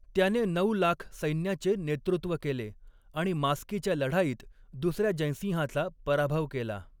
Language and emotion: Marathi, neutral